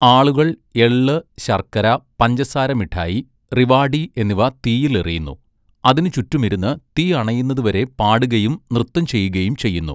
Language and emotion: Malayalam, neutral